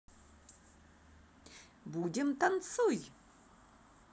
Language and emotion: Russian, positive